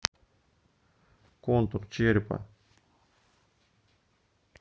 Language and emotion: Russian, neutral